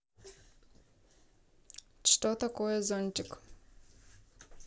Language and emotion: Russian, neutral